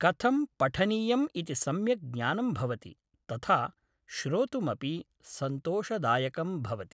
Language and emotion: Sanskrit, neutral